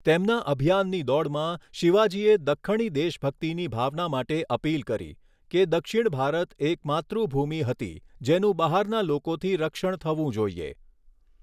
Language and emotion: Gujarati, neutral